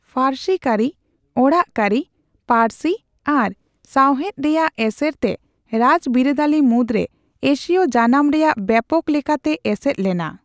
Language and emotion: Santali, neutral